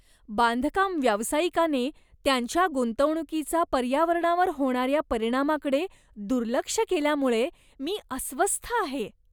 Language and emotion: Marathi, disgusted